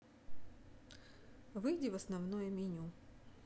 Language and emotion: Russian, neutral